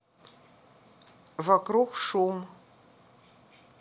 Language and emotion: Russian, neutral